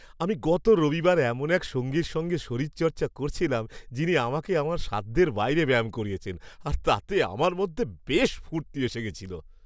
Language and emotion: Bengali, happy